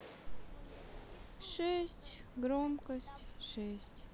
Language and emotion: Russian, sad